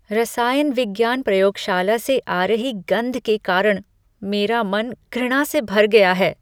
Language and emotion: Hindi, disgusted